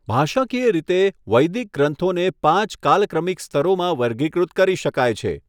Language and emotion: Gujarati, neutral